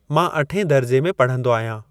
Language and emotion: Sindhi, neutral